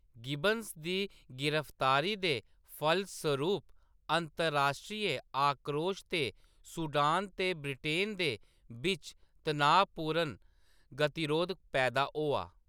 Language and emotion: Dogri, neutral